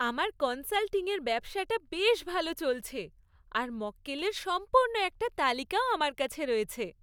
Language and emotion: Bengali, happy